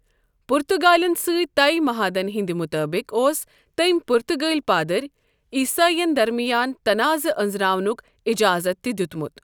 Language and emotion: Kashmiri, neutral